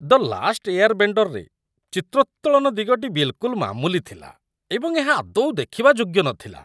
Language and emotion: Odia, disgusted